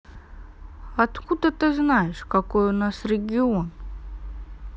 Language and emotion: Russian, neutral